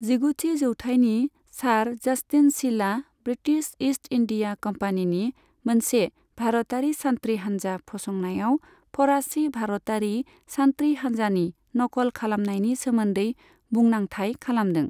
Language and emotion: Bodo, neutral